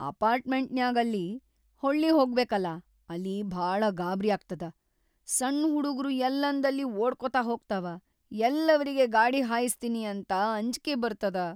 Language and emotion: Kannada, fearful